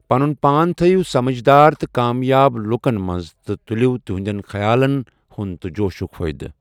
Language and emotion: Kashmiri, neutral